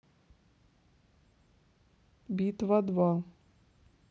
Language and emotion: Russian, neutral